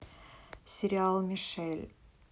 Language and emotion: Russian, neutral